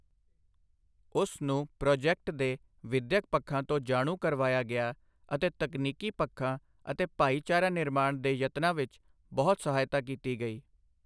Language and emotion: Punjabi, neutral